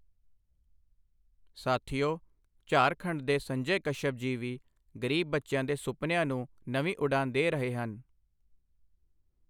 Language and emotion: Punjabi, neutral